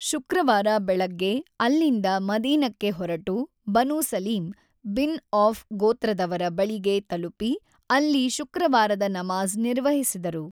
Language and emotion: Kannada, neutral